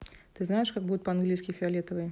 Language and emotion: Russian, neutral